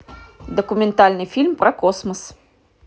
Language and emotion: Russian, positive